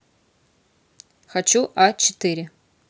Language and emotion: Russian, neutral